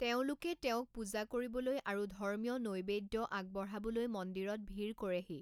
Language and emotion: Assamese, neutral